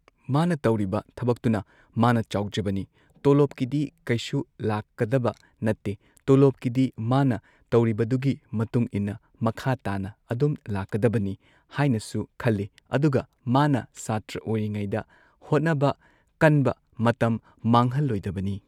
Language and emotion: Manipuri, neutral